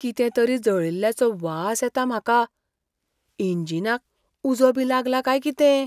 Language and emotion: Goan Konkani, fearful